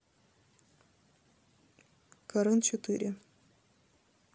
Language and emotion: Russian, neutral